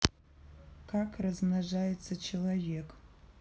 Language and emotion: Russian, neutral